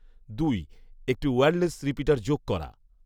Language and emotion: Bengali, neutral